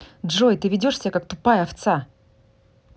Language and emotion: Russian, angry